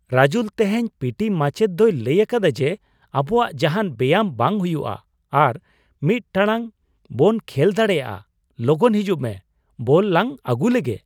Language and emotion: Santali, surprised